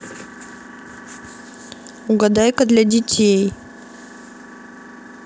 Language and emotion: Russian, neutral